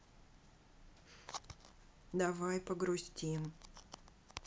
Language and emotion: Russian, sad